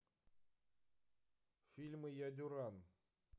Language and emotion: Russian, neutral